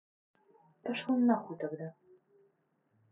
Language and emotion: Russian, angry